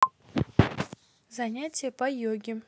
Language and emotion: Russian, neutral